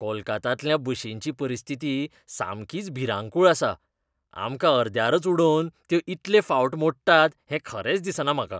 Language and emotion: Goan Konkani, disgusted